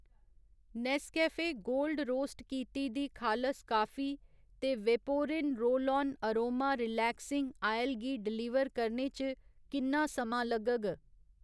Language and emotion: Dogri, neutral